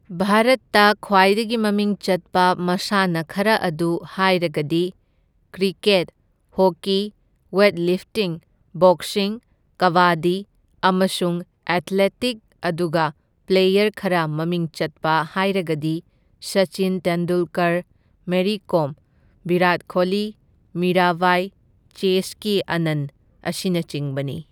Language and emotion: Manipuri, neutral